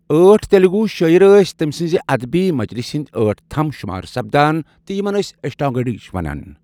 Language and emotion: Kashmiri, neutral